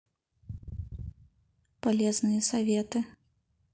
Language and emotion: Russian, neutral